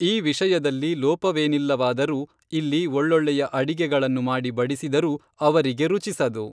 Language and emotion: Kannada, neutral